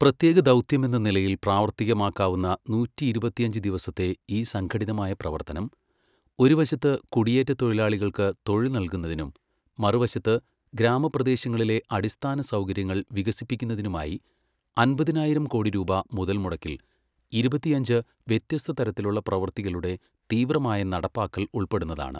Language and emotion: Malayalam, neutral